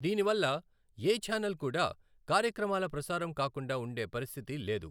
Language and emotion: Telugu, neutral